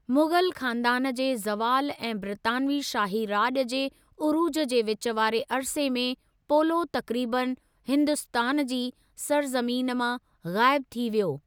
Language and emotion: Sindhi, neutral